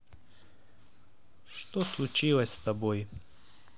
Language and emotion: Russian, neutral